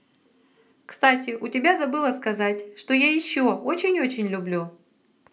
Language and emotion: Russian, positive